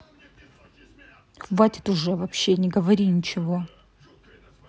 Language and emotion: Russian, angry